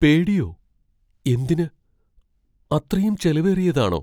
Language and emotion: Malayalam, fearful